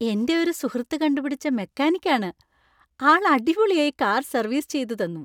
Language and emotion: Malayalam, happy